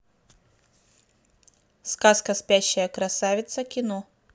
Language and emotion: Russian, neutral